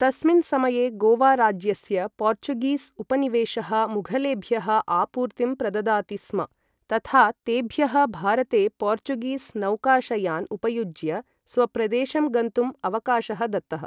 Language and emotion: Sanskrit, neutral